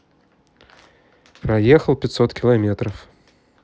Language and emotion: Russian, neutral